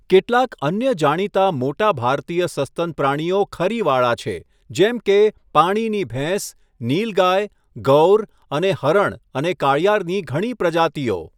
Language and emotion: Gujarati, neutral